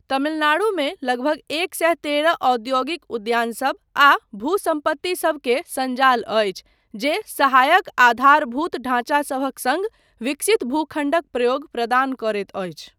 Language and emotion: Maithili, neutral